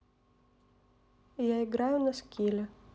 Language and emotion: Russian, neutral